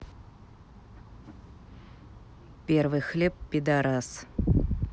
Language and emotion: Russian, neutral